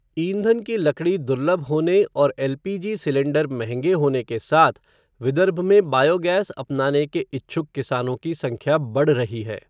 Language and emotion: Hindi, neutral